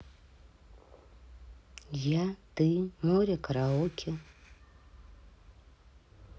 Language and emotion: Russian, neutral